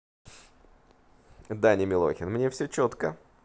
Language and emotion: Russian, neutral